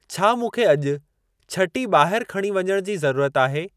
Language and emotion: Sindhi, neutral